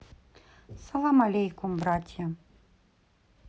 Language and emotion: Russian, neutral